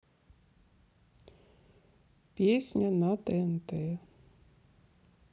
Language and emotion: Russian, sad